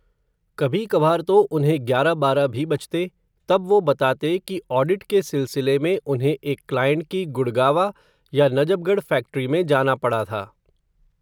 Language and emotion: Hindi, neutral